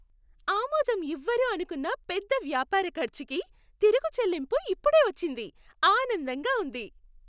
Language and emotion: Telugu, happy